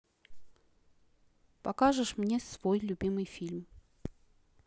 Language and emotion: Russian, neutral